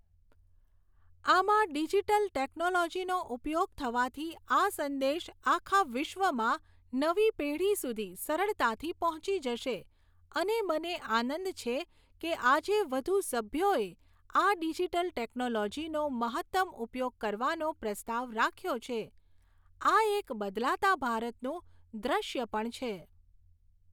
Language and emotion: Gujarati, neutral